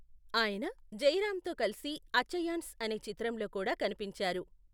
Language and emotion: Telugu, neutral